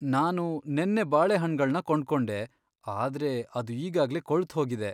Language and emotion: Kannada, sad